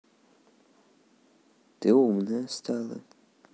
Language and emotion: Russian, neutral